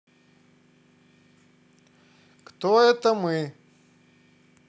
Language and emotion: Russian, positive